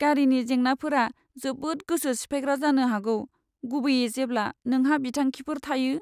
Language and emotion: Bodo, sad